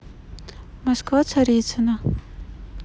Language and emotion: Russian, neutral